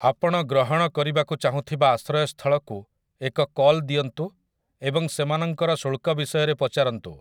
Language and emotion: Odia, neutral